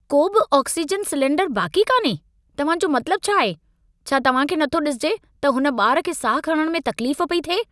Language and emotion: Sindhi, angry